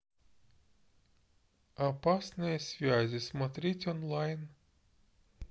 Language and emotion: Russian, neutral